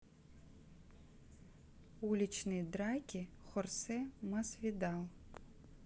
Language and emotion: Russian, neutral